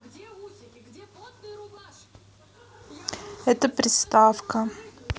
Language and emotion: Russian, neutral